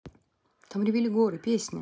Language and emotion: Russian, neutral